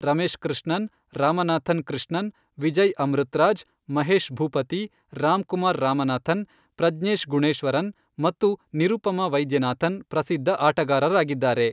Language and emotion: Kannada, neutral